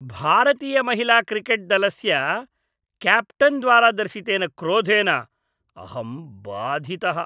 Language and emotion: Sanskrit, disgusted